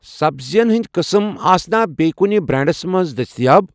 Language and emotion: Kashmiri, neutral